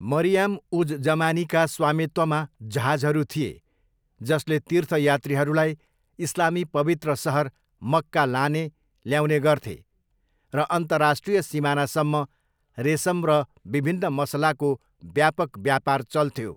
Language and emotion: Nepali, neutral